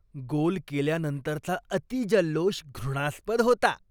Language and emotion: Marathi, disgusted